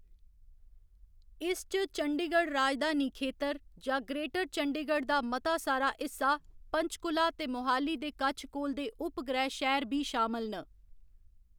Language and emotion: Dogri, neutral